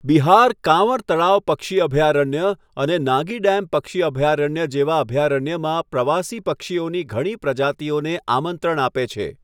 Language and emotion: Gujarati, neutral